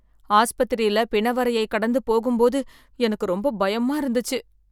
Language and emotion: Tamil, fearful